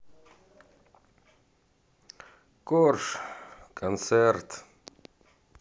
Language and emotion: Russian, sad